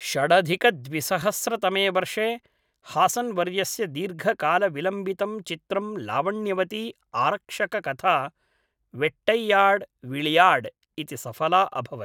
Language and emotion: Sanskrit, neutral